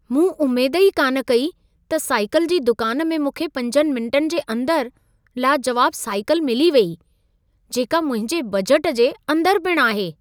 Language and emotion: Sindhi, surprised